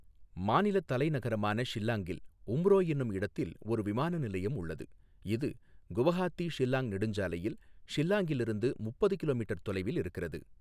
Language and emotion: Tamil, neutral